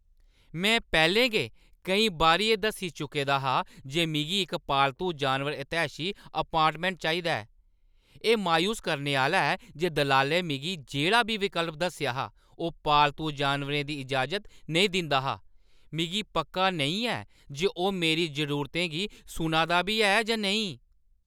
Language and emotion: Dogri, angry